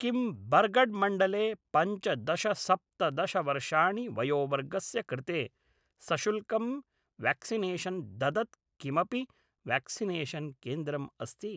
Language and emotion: Sanskrit, neutral